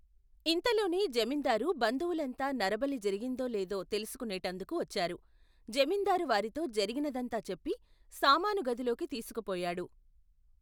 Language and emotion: Telugu, neutral